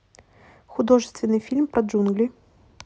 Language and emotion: Russian, neutral